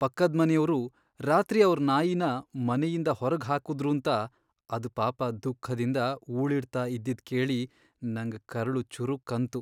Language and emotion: Kannada, sad